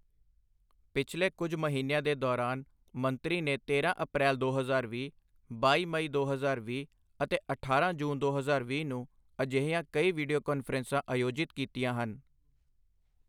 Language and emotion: Punjabi, neutral